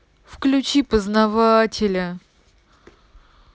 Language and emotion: Russian, sad